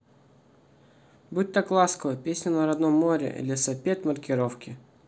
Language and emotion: Russian, neutral